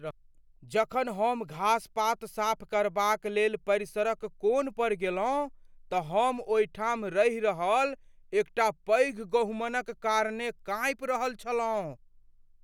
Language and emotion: Maithili, fearful